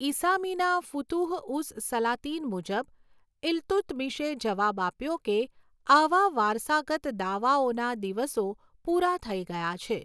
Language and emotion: Gujarati, neutral